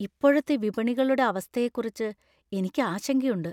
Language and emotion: Malayalam, fearful